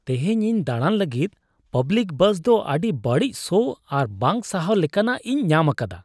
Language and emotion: Santali, disgusted